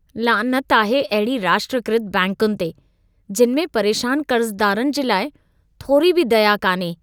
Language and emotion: Sindhi, disgusted